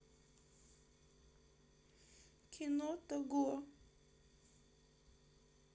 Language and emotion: Russian, sad